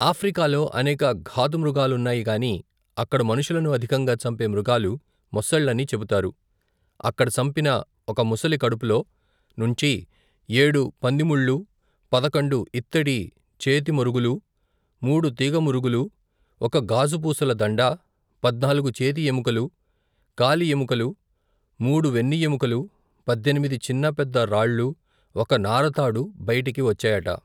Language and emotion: Telugu, neutral